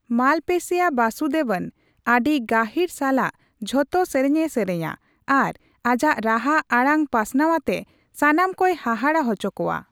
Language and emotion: Santali, neutral